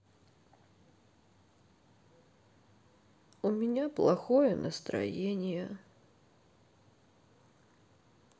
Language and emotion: Russian, sad